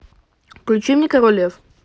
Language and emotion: Russian, neutral